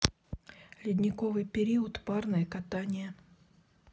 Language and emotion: Russian, neutral